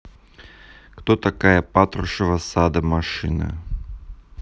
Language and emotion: Russian, neutral